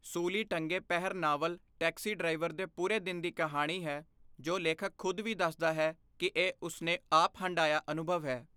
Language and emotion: Punjabi, neutral